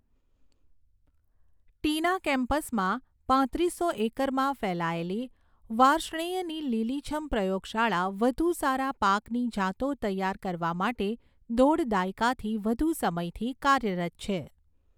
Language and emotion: Gujarati, neutral